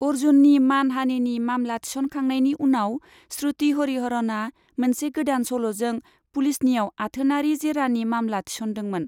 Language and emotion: Bodo, neutral